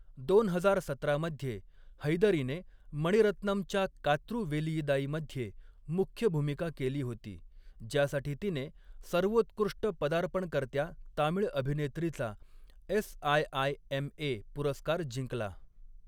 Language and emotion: Marathi, neutral